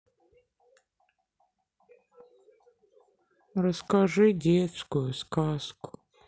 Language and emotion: Russian, sad